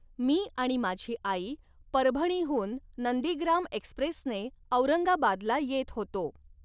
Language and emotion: Marathi, neutral